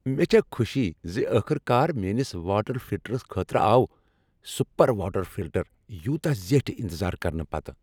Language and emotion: Kashmiri, happy